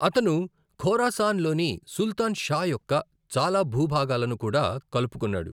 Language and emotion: Telugu, neutral